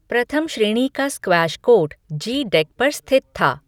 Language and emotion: Hindi, neutral